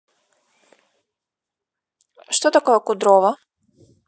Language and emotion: Russian, neutral